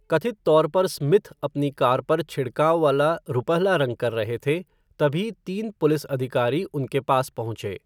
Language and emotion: Hindi, neutral